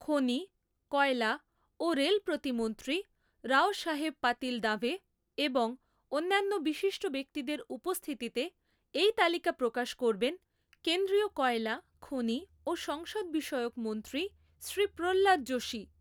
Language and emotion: Bengali, neutral